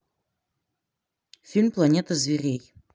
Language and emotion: Russian, neutral